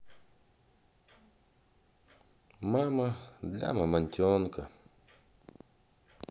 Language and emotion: Russian, sad